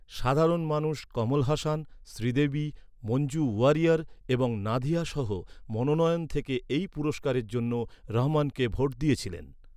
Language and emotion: Bengali, neutral